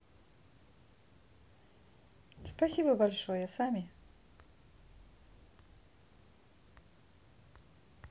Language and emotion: Russian, positive